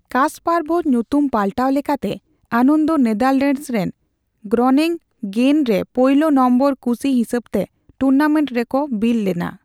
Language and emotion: Santali, neutral